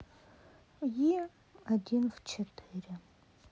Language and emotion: Russian, sad